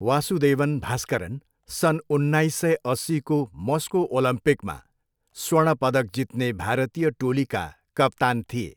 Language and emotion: Nepali, neutral